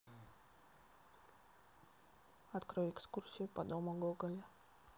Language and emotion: Russian, neutral